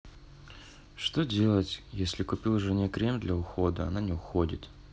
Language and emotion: Russian, sad